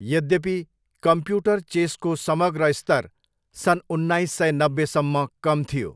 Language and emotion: Nepali, neutral